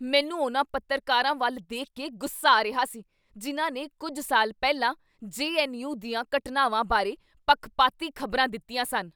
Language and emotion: Punjabi, angry